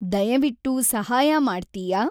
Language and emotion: Kannada, neutral